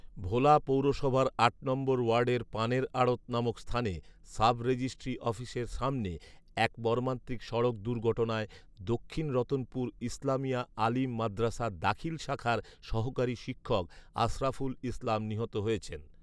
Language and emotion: Bengali, neutral